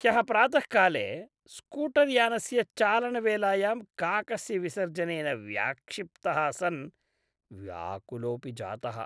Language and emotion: Sanskrit, disgusted